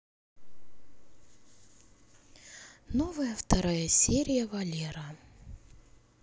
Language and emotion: Russian, sad